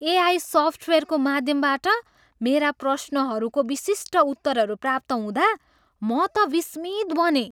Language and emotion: Nepali, surprised